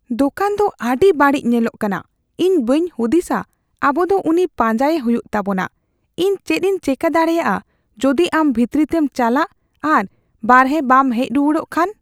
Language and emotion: Santali, fearful